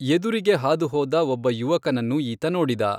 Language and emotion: Kannada, neutral